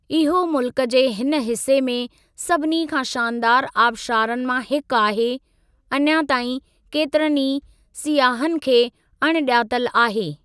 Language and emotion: Sindhi, neutral